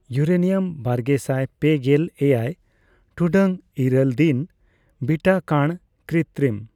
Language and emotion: Santali, neutral